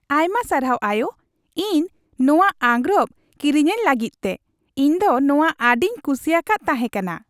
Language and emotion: Santali, happy